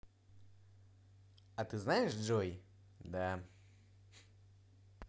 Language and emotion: Russian, positive